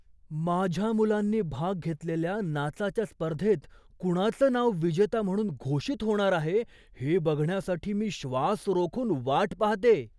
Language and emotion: Marathi, surprised